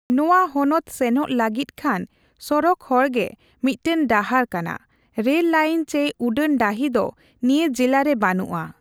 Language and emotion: Santali, neutral